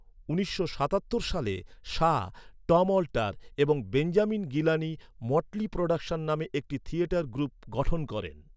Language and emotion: Bengali, neutral